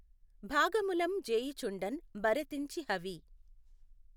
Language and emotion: Telugu, neutral